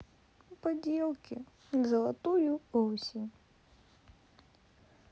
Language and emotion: Russian, sad